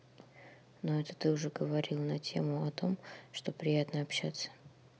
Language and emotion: Russian, neutral